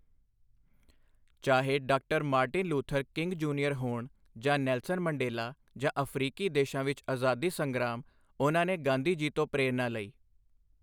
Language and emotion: Punjabi, neutral